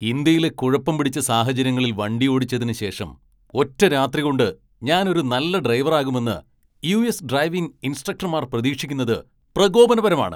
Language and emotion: Malayalam, angry